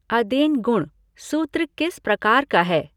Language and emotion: Hindi, neutral